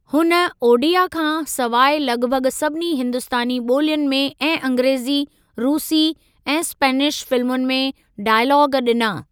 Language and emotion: Sindhi, neutral